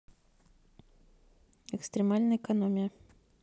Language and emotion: Russian, neutral